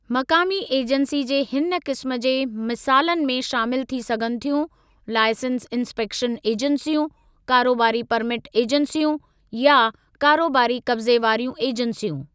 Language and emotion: Sindhi, neutral